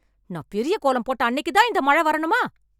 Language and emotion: Tamil, angry